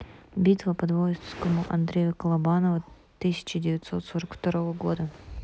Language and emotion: Russian, neutral